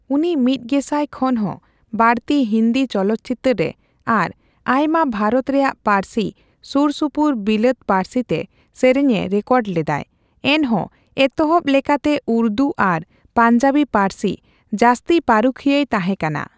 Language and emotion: Santali, neutral